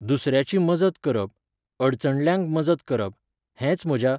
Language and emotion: Goan Konkani, neutral